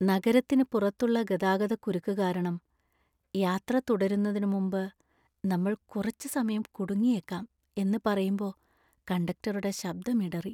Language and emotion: Malayalam, sad